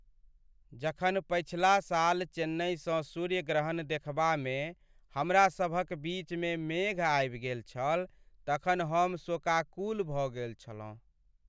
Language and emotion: Maithili, sad